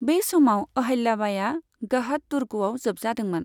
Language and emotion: Bodo, neutral